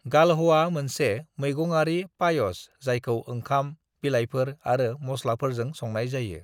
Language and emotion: Bodo, neutral